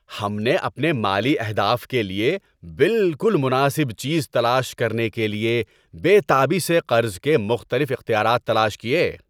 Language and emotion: Urdu, happy